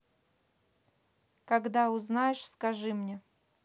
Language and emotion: Russian, neutral